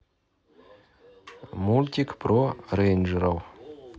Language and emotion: Russian, neutral